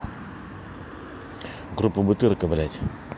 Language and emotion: Russian, angry